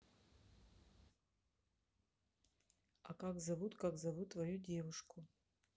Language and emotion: Russian, neutral